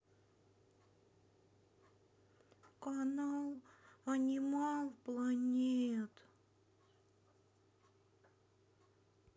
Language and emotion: Russian, sad